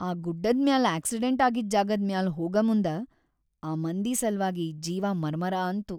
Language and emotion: Kannada, sad